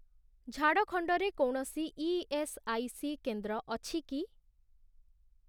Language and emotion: Odia, neutral